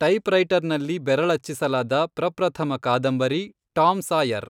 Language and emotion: Kannada, neutral